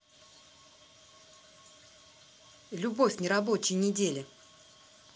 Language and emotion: Russian, angry